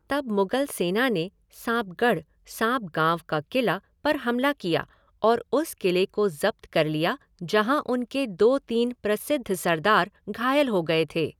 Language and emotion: Hindi, neutral